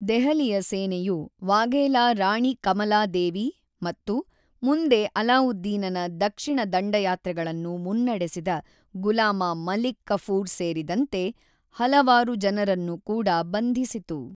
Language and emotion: Kannada, neutral